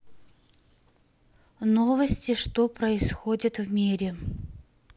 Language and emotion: Russian, neutral